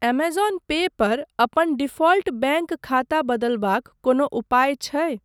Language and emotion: Maithili, neutral